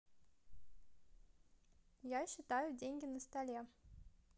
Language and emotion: Russian, positive